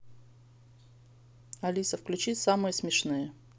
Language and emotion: Russian, neutral